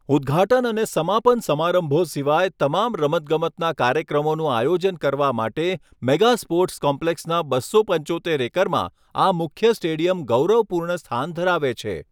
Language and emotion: Gujarati, neutral